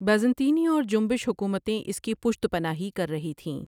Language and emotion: Urdu, neutral